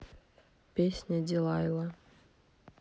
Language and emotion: Russian, neutral